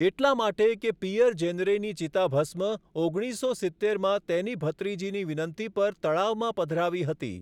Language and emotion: Gujarati, neutral